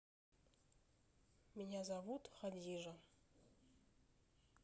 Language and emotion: Russian, neutral